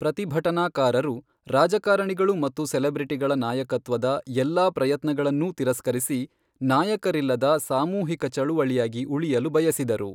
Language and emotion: Kannada, neutral